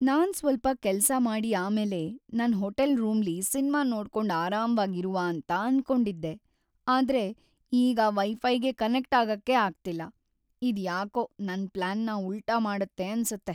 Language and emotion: Kannada, sad